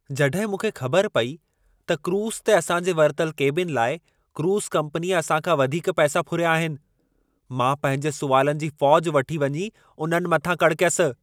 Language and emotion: Sindhi, angry